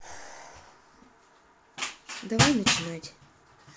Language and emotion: Russian, neutral